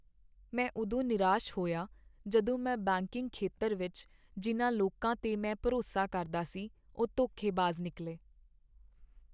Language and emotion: Punjabi, sad